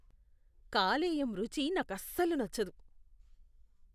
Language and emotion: Telugu, disgusted